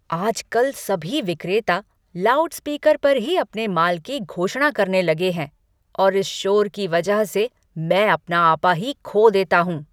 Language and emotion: Hindi, angry